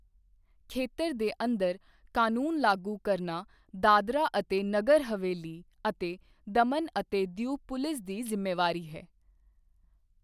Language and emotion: Punjabi, neutral